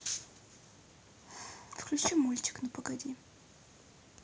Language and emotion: Russian, neutral